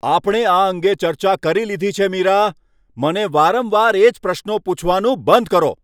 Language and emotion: Gujarati, angry